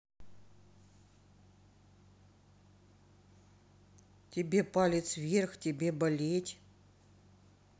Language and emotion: Russian, sad